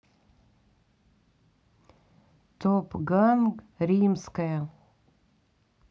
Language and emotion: Russian, neutral